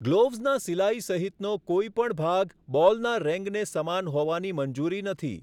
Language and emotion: Gujarati, neutral